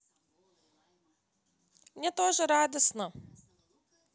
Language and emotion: Russian, positive